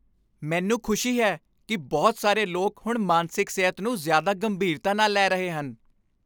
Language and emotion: Punjabi, happy